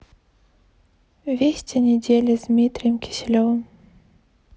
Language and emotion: Russian, neutral